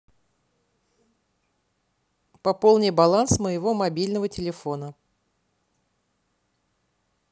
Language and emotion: Russian, neutral